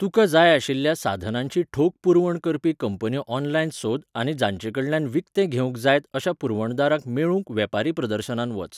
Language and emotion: Goan Konkani, neutral